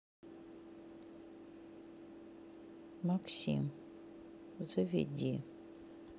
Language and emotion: Russian, neutral